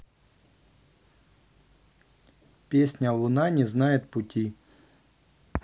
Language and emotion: Russian, neutral